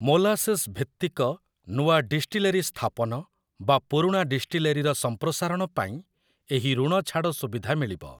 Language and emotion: Odia, neutral